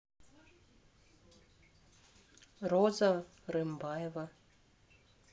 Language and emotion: Russian, neutral